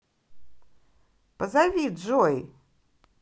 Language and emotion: Russian, positive